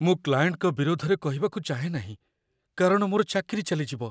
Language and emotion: Odia, fearful